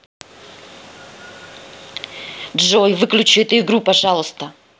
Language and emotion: Russian, angry